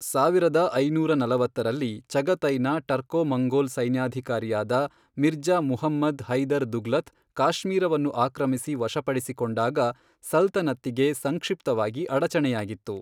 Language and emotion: Kannada, neutral